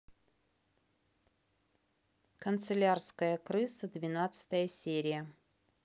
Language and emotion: Russian, neutral